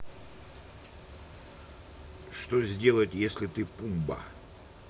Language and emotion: Russian, neutral